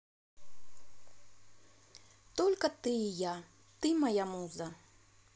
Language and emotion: Russian, positive